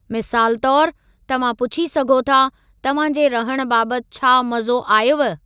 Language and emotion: Sindhi, neutral